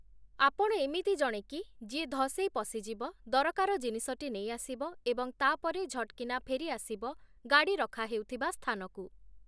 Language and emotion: Odia, neutral